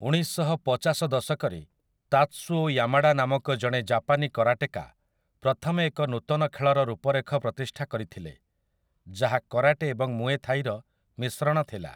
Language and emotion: Odia, neutral